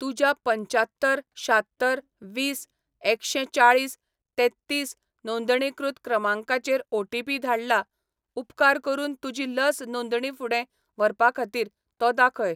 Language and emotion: Goan Konkani, neutral